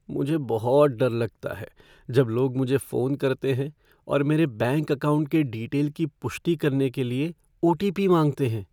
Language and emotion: Hindi, fearful